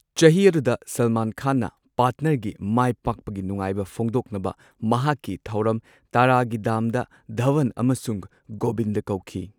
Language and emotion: Manipuri, neutral